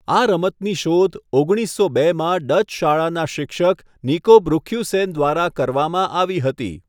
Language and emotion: Gujarati, neutral